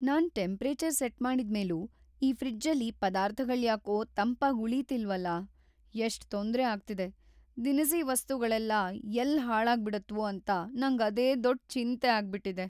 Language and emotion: Kannada, fearful